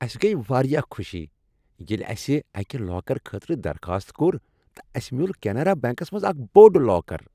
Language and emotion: Kashmiri, happy